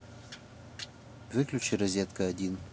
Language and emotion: Russian, neutral